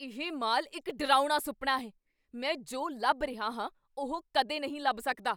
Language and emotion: Punjabi, angry